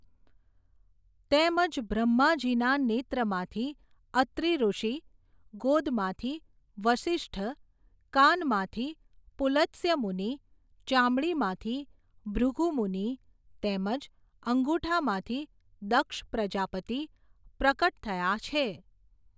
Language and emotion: Gujarati, neutral